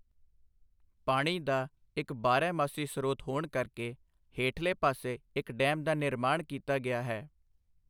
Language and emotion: Punjabi, neutral